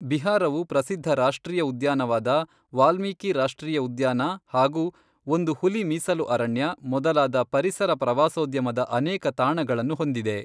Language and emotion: Kannada, neutral